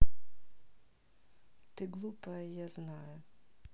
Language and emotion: Russian, neutral